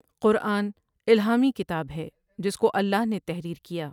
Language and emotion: Urdu, neutral